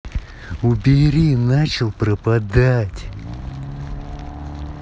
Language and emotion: Russian, angry